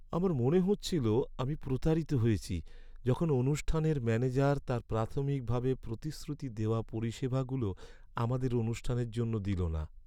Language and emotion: Bengali, sad